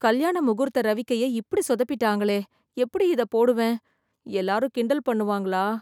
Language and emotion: Tamil, fearful